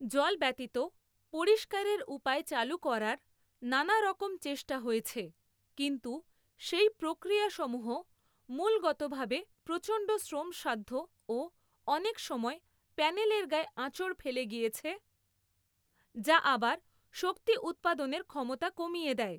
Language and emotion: Bengali, neutral